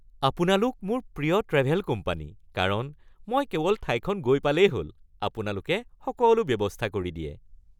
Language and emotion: Assamese, happy